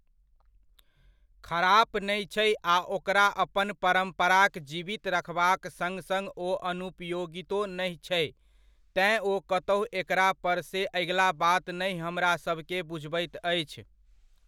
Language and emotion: Maithili, neutral